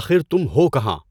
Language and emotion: Urdu, neutral